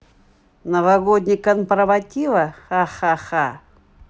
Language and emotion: Russian, neutral